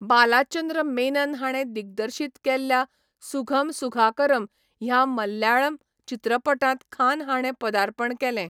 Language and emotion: Goan Konkani, neutral